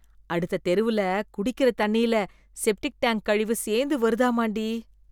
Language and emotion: Tamil, disgusted